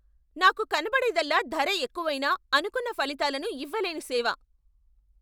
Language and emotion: Telugu, angry